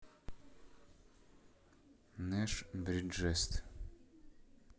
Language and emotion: Russian, neutral